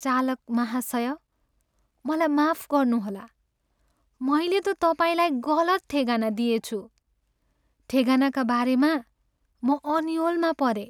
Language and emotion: Nepali, sad